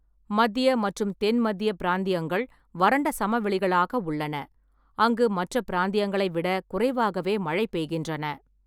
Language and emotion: Tamil, neutral